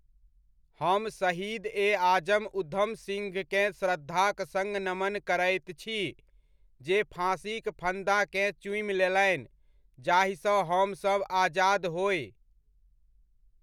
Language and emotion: Maithili, neutral